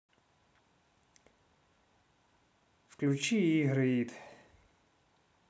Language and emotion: Russian, neutral